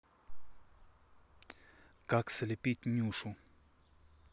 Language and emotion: Russian, neutral